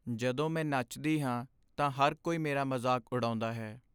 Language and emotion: Punjabi, sad